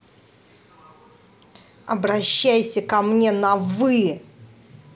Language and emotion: Russian, angry